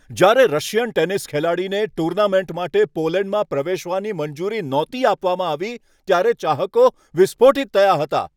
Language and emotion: Gujarati, angry